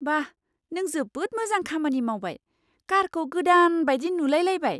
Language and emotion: Bodo, surprised